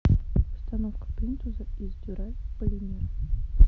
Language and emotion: Russian, neutral